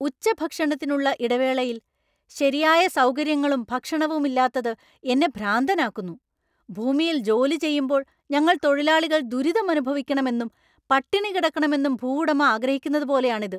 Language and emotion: Malayalam, angry